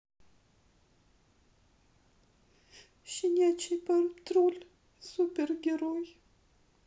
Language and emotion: Russian, sad